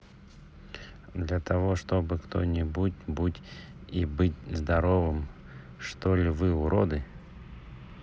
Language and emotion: Russian, neutral